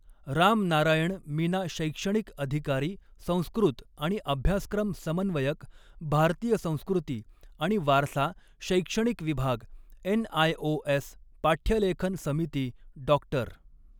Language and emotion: Marathi, neutral